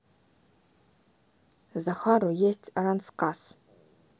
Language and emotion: Russian, neutral